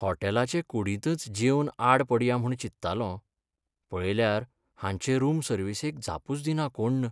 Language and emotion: Goan Konkani, sad